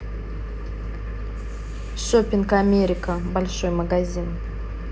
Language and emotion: Russian, neutral